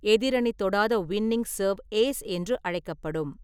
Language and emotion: Tamil, neutral